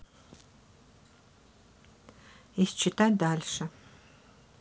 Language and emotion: Russian, neutral